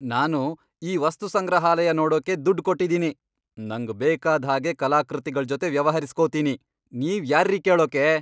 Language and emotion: Kannada, angry